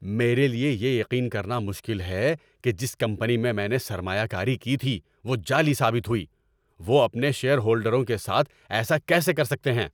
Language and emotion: Urdu, angry